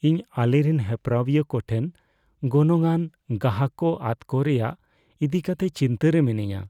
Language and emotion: Santali, fearful